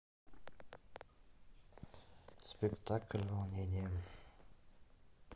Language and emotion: Russian, neutral